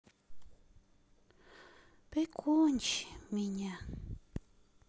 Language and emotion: Russian, sad